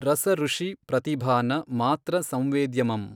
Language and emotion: Kannada, neutral